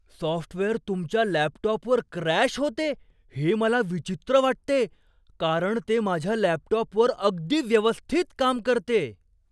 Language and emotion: Marathi, surprised